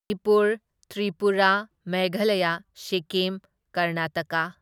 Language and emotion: Manipuri, neutral